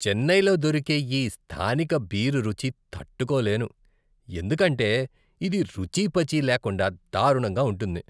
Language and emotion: Telugu, disgusted